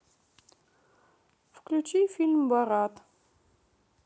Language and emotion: Russian, neutral